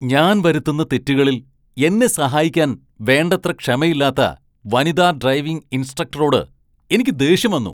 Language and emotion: Malayalam, angry